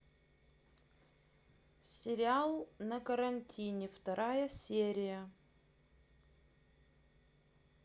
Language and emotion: Russian, neutral